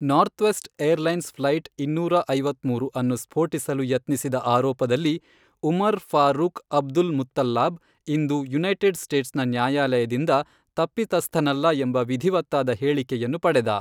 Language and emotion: Kannada, neutral